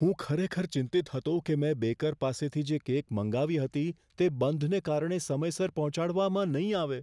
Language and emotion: Gujarati, fearful